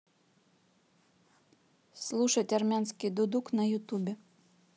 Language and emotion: Russian, neutral